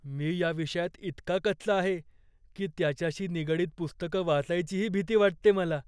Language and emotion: Marathi, fearful